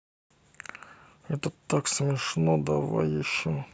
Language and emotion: Russian, neutral